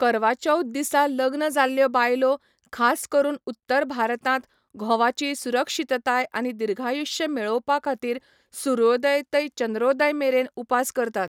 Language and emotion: Goan Konkani, neutral